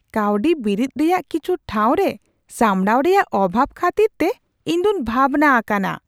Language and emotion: Santali, surprised